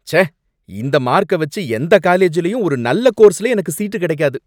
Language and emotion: Tamil, angry